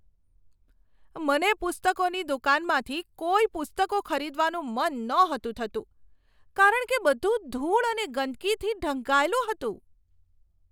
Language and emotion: Gujarati, disgusted